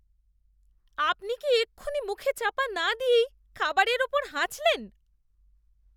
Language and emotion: Bengali, disgusted